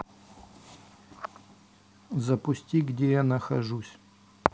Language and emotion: Russian, neutral